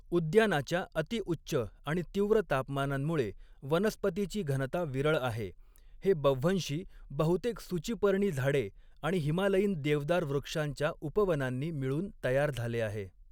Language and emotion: Marathi, neutral